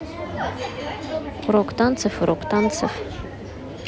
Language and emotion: Russian, neutral